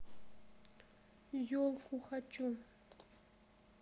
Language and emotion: Russian, sad